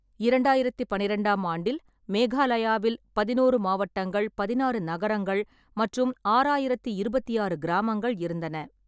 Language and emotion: Tamil, neutral